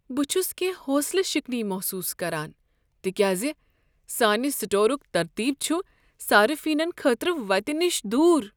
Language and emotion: Kashmiri, sad